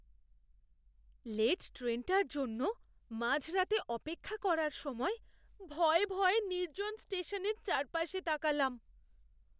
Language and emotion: Bengali, fearful